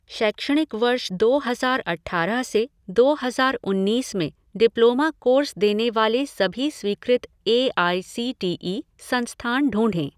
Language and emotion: Hindi, neutral